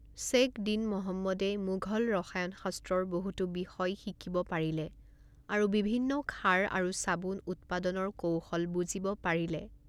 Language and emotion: Assamese, neutral